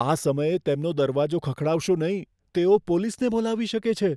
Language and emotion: Gujarati, fearful